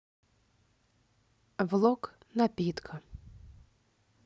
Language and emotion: Russian, neutral